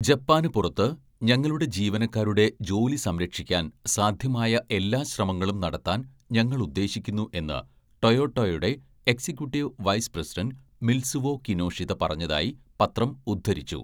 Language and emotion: Malayalam, neutral